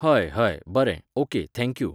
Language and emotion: Goan Konkani, neutral